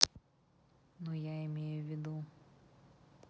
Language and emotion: Russian, neutral